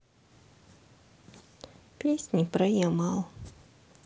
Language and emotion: Russian, sad